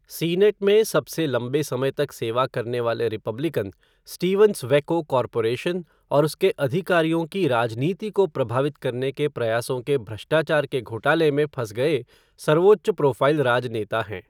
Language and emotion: Hindi, neutral